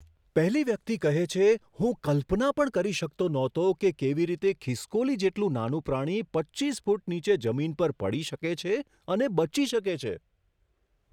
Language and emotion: Gujarati, surprised